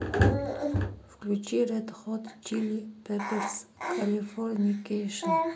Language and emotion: Russian, neutral